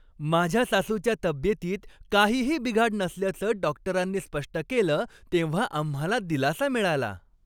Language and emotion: Marathi, happy